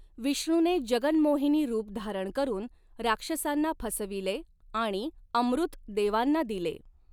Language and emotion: Marathi, neutral